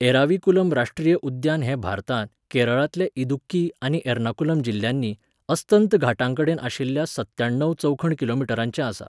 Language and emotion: Goan Konkani, neutral